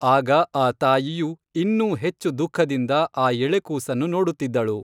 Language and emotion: Kannada, neutral